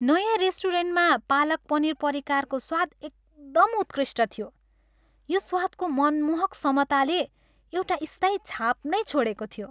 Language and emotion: Nepali, happy